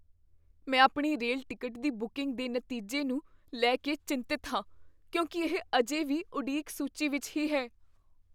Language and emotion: Punjabi, fearful